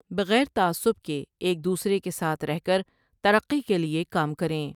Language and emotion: Urdu, neutral